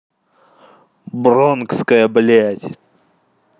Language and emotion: Russian, angry